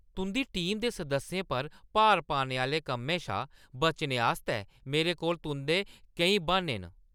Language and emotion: Dogri, angry